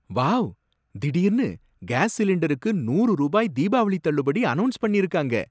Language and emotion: Tamil, surprised